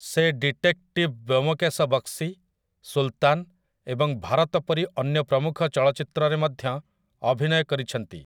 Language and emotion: Odia, neutral